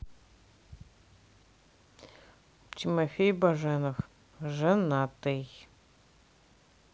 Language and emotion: Russian, neutral